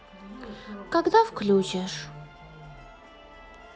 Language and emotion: Russian, sad